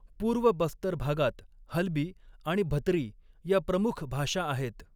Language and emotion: Marathi, neutral